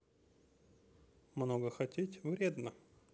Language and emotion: Russian, neutral